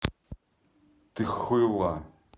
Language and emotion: Russian, angry